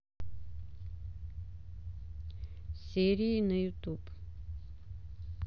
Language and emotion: Russian, neutral